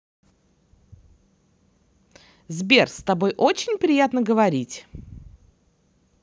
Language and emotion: Russian, positive